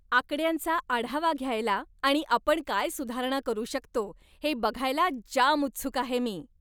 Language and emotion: Marathi, happy